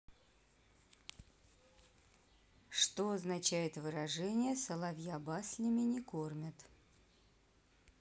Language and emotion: Russian, neutral